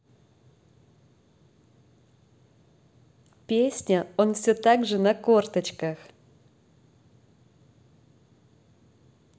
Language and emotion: Russian, positive